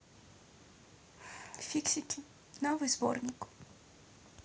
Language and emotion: Russian, neutral